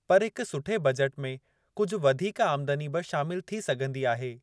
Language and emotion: Sindhi, neutral